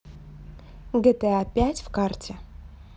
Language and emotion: Russian, neutral